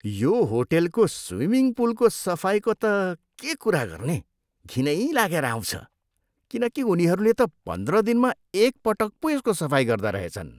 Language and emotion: Nepali, disgusted